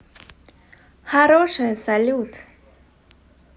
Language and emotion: Russian, positive